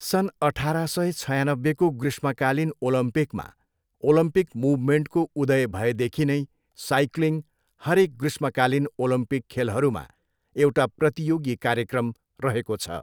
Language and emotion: Nepali, neutral